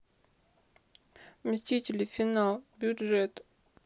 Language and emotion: Russian, sad